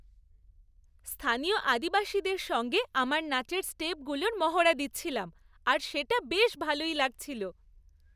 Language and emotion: Bengali, happy